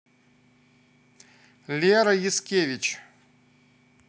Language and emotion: Russian, positive